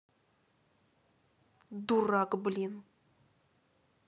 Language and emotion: Russian, angry